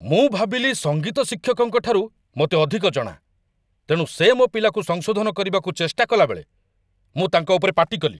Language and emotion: Odia, angry